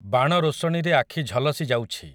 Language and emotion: Odia, neutral